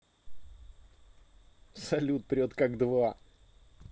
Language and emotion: Russian, positive